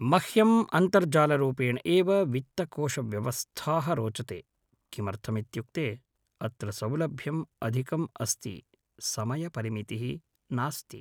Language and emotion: Sanskrit, neutral